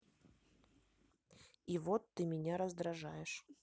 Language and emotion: Russian, neutral